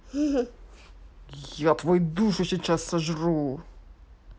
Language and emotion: Russian, angry